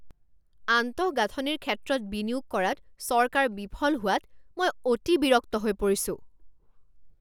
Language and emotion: Assamese, angry